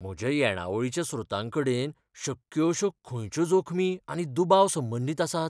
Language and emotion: Goan Konkani, fearful